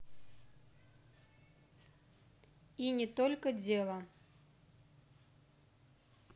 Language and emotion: Russian, neutral